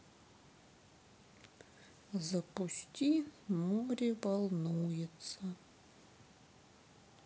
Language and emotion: Russian, sad